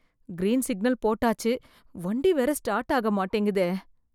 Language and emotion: Tamil, fearful